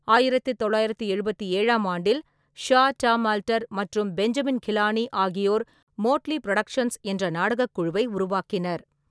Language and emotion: Tamil, neutral